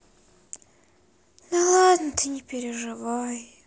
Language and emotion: Russian, sad